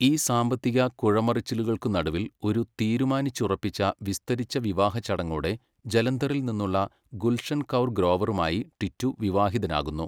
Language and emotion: Malayalam, neutral